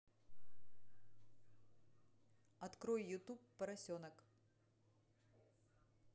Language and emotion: Russian, neutral